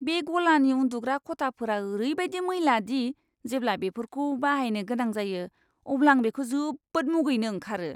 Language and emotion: Bodo, disgusted